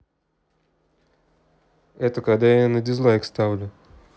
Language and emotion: Russian, neutral